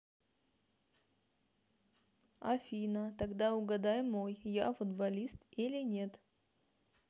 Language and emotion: Russian, neutral